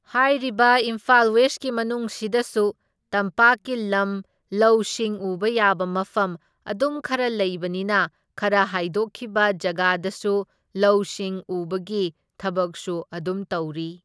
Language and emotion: Manipuri, neutral